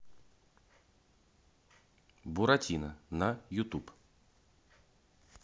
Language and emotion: Russian, neutral